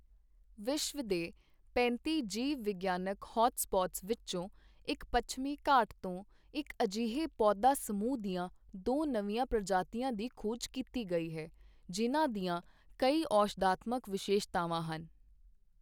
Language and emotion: Punjabi, neutral